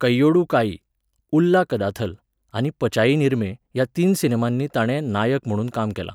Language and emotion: Goan Konkani, neutral